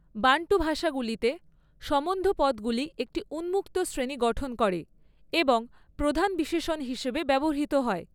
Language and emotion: Bengali, neutral